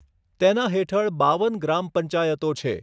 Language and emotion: Gujarati, neutral